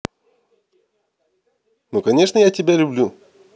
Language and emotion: Russian, neutral